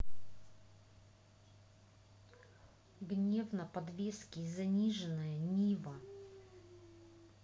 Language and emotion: Russian, angry